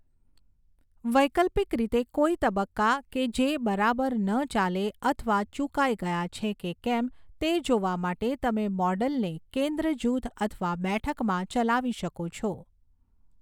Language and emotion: Gujarati, neutral